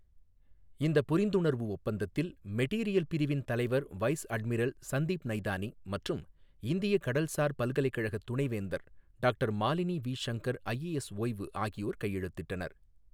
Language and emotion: Tamil, neutral